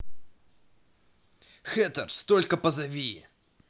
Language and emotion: Russian, neutral